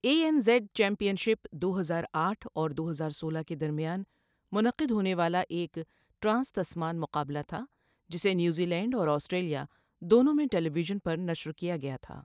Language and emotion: Urdu, neutral